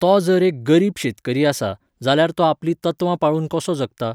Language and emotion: Goan Konkani, neutral